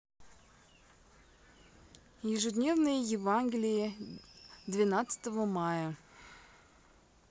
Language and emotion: Russian, neutral